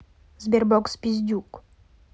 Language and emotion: Russian, neutral